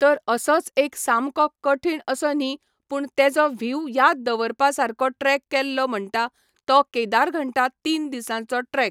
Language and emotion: Goan Konkani, neutral